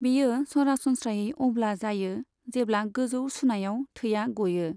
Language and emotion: Bodo, neutral